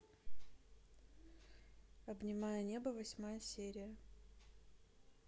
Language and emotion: Russian, neutral